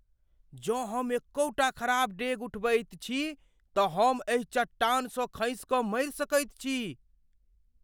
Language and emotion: Maithili, fearful